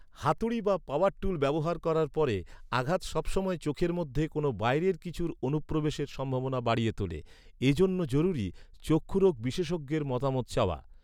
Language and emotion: Bengali, neutral